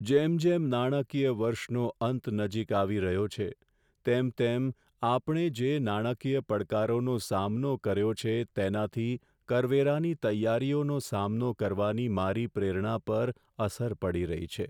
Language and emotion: Gujarati, sad